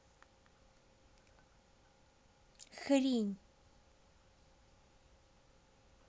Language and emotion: Russian, angry